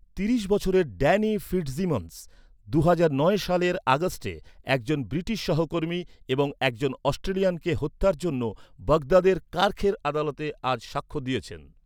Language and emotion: Bengali, neutral